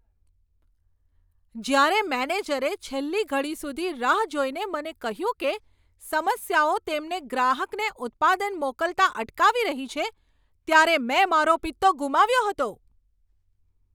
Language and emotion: Gujarati, angry